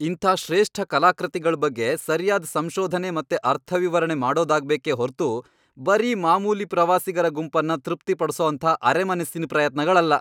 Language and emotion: Kannada, angry